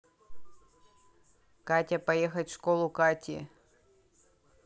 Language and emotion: Russian, neutral